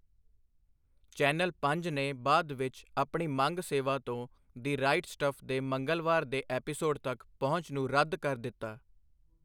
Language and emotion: Punjabi, neutral